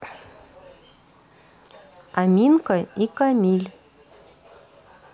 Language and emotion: Russian, neutral